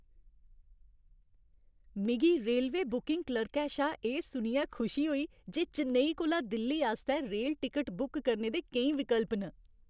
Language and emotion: Dogri, happy